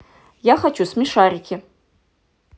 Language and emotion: Russian, angry